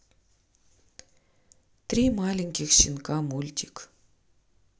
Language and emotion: Russian, neutral